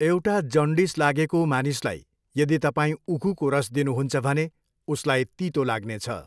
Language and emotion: Nepali, neutral